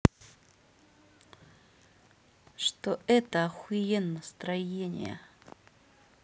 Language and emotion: Russian, neutral